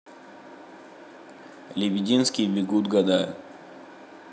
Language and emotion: Russian, neutral